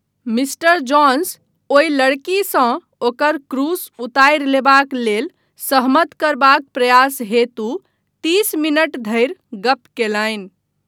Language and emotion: Maithili, neutral